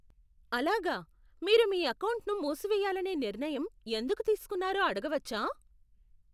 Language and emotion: Telugu, surprised